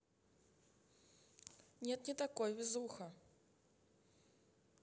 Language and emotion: Russian, neutral